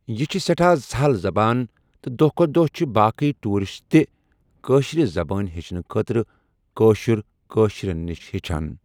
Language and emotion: Kashmiri, neutral